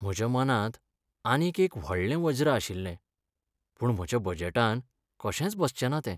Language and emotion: Goan Konkani, sad